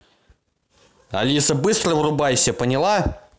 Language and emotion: Russian, angry